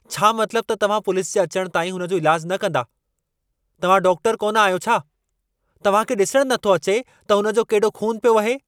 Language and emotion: Sindhi, angry